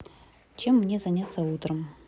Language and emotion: Russian, neutral